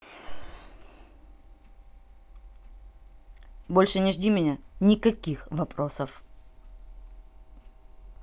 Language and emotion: Russian, angry